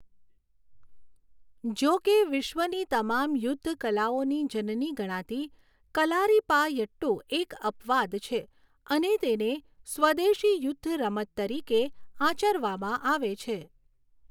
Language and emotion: Gujarati, neutral